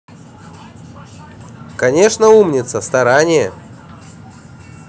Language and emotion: Russian, positive